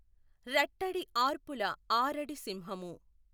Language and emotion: Telugu, neutral